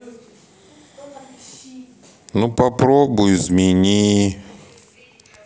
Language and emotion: Russian, sad